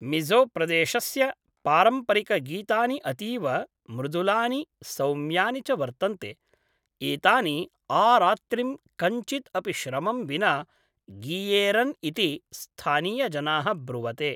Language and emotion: Sanskrit, neutral